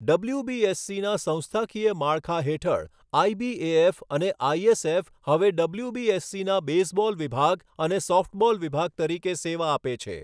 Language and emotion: Gujarati, neutral